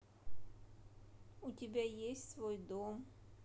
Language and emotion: Russian, sad